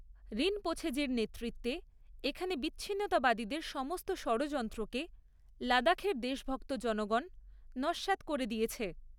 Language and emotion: Bengali, neutral